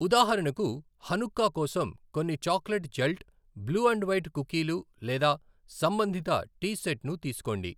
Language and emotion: Telugu, neutral